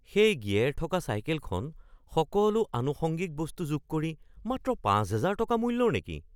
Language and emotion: Assamese, surprised